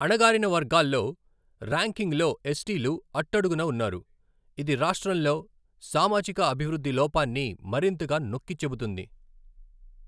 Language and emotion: Telugu, neutral